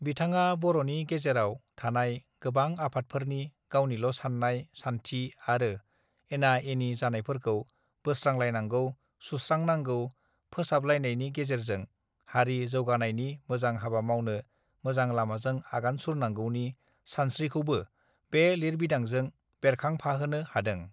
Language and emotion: Bodo, neutral